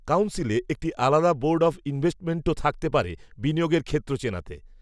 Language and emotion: Bengali, neutral